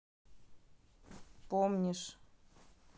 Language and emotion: Russian, neutral